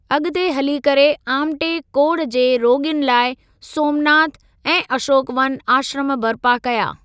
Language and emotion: Sindhi, neutral